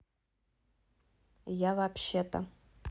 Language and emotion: Russian, neutral